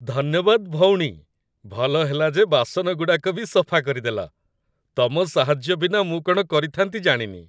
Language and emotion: Odia, happy